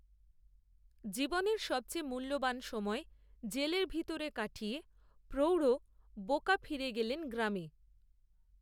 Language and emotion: Bengali, neutral